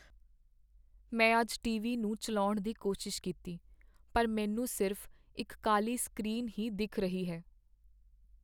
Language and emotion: Punjabi, sad